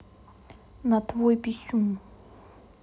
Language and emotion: Russian, neutral